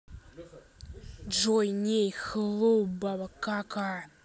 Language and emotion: Russian, angry